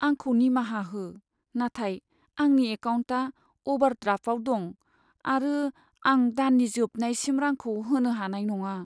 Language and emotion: Bodo, sad